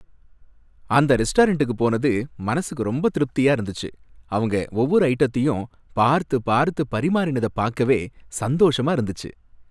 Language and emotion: Tamil, happy